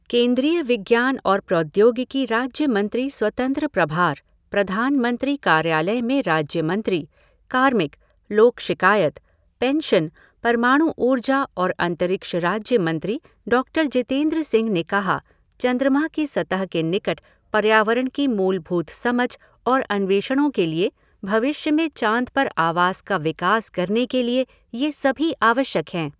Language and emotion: Hindi, neutral